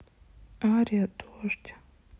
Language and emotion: Russian, sad